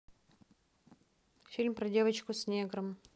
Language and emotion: Russian, neutral